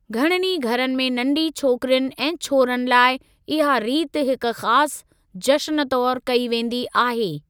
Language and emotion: Sindhi, neutral